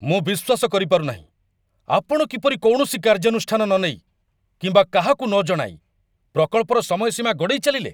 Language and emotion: Odia, angry